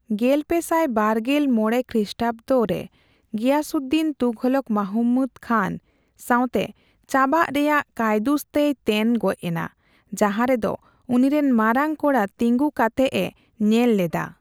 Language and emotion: Santali, neutral